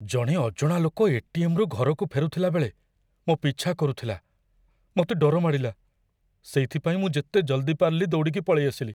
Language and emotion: Odia, fearful